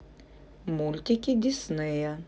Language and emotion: Russian, neutral